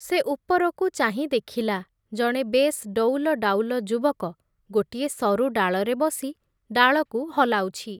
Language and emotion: Odia, neutral